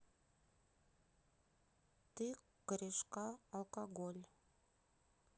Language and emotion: Russian, neutral